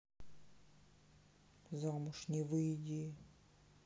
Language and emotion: Russian, sad